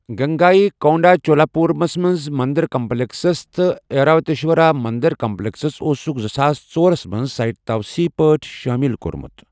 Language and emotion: Kashmiri, neutral